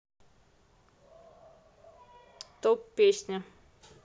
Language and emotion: Russian, neutral